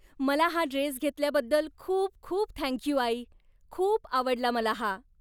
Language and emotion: Marathi, happy